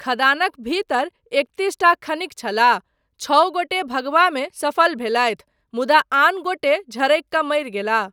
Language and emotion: Maithili, neutral